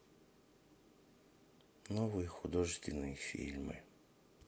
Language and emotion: Russian, sad